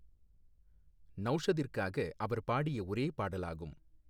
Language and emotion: Tamil, neutral